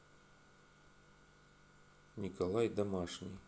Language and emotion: Russian, neutral